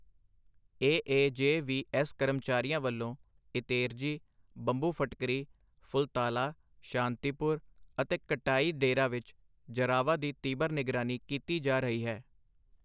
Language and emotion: Punjabi, neutral